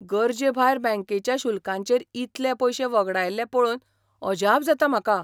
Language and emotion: Goan Konkani, surprised